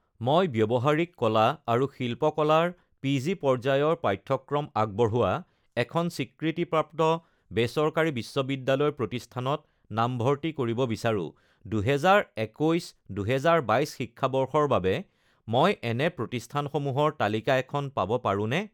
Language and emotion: Assamese, neutral